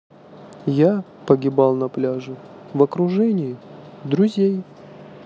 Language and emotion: Russian, sad